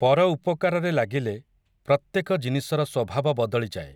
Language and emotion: Odia, neutral